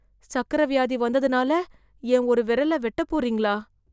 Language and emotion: Tamil, fearful